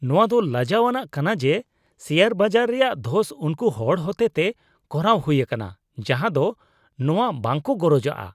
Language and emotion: Santali, disgusted